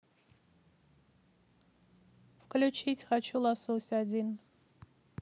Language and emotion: Russian, neutral